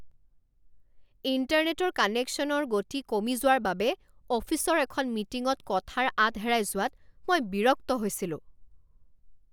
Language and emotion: Assamese, angry